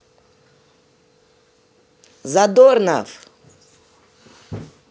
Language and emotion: Russian, positive